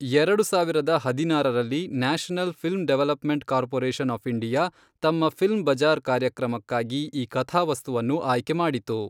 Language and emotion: Kannada, neutral